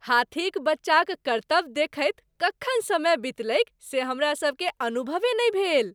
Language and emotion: Maithili, happy